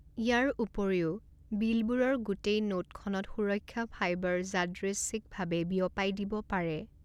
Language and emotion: Assamese, neutral